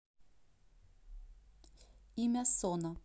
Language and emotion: Russian, neutral